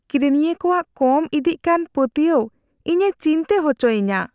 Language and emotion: Santali, fearful